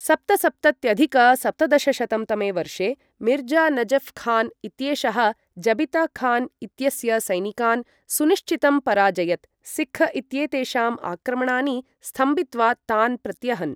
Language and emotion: Sanskrit, neutral